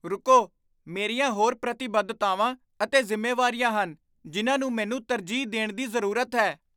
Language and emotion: Punjabi, surprised